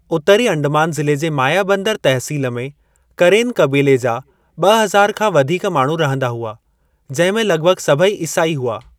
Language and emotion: Sindhi, neutral